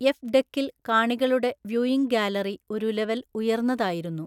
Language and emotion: Malayalam, neutral